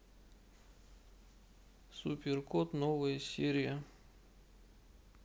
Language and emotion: Russian, neutral